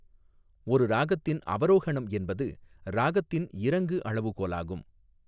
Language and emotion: Tamil, neutral